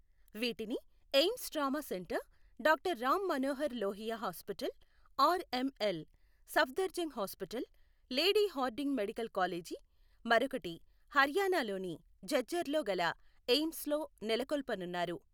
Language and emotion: Telugu, neutral